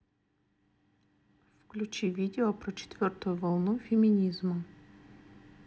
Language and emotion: Russian, neutral